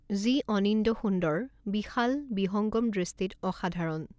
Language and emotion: Assamese, neutral